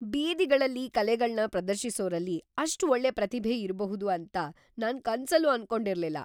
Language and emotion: Kannada, surprised